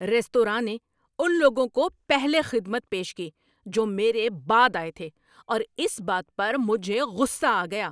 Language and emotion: Urdu, angry